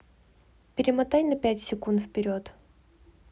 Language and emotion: Russian, neutral